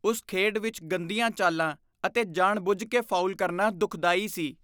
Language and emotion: Punjabi, disgusted